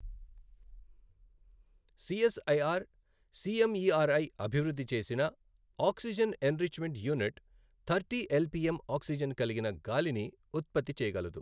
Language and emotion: Telugu, neutral